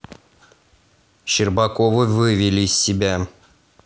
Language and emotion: Russian, angry